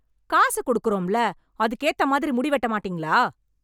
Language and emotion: Tamil, angry